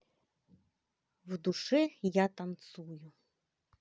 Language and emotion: Russian, positive